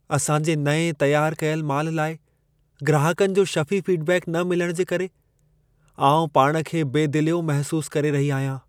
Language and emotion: Sindhi, sad